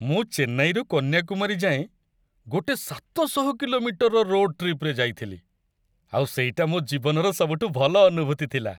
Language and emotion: Odia, happy